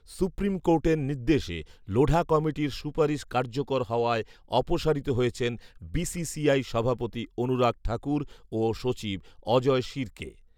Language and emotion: Bengali, neutral